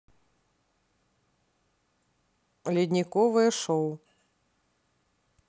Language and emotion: Russian, neutral